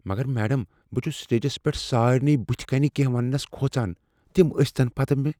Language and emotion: Kashmiri, fearful